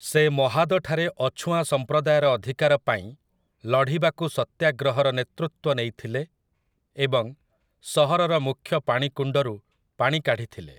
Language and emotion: Odia, neutral